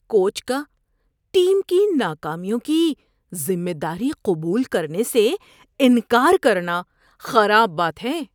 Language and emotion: Urdu, disgusted